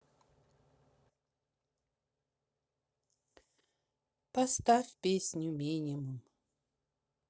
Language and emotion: Russian, sad